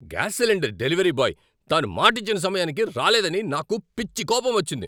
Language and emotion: Telugu, angry